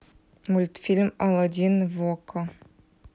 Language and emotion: Russian, neutral